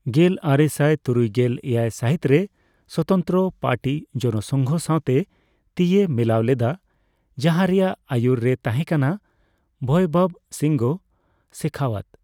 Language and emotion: Santali, neutral